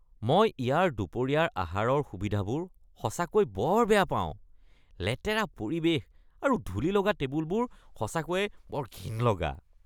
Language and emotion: Assamese, disgusted